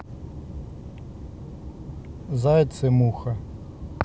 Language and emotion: Russian, neutral